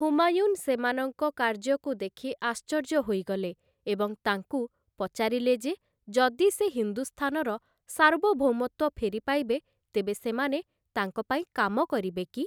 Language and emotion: Odia, neutral